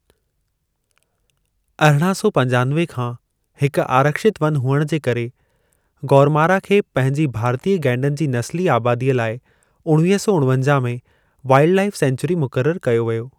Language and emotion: Sindhi, neutral